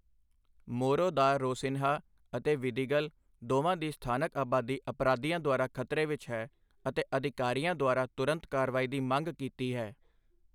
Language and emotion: Punjabi, neutral